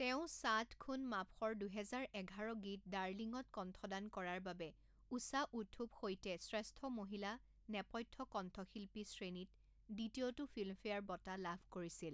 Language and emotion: Assamese, neutral